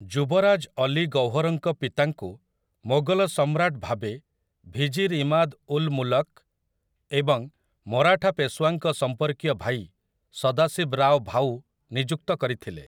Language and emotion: Odia, neutral